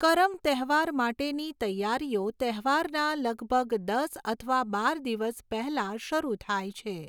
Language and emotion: Gujarati, neutral